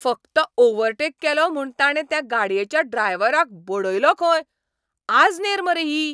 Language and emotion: Goan Konkani, angry